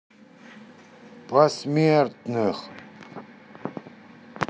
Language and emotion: Russian, angry